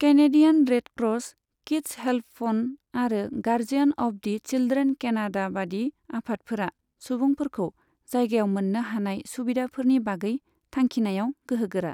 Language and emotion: Bodo, neutral